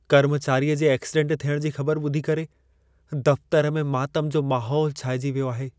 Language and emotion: Sindhi, sad